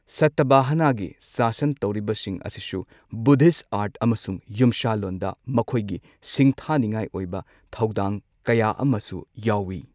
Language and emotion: Manipuri, neutral